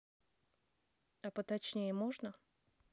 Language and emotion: Russian, neutral